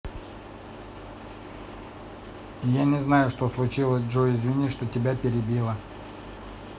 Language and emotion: Russian, neutral